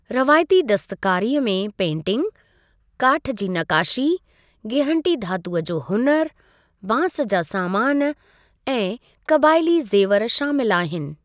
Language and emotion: Sindhi, neutral